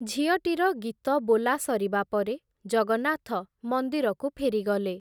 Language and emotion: Odia, neutral